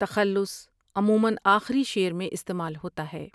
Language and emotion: Urdu, neutral